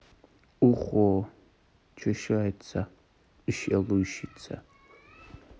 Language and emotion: Russian, neutral